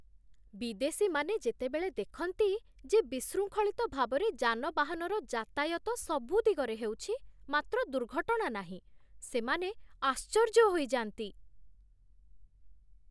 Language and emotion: Odia, surprised